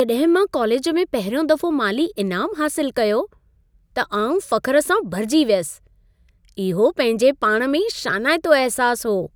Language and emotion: Sindhi, happy